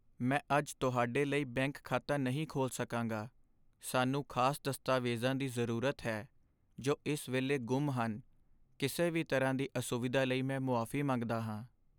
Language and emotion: Punjabi, sad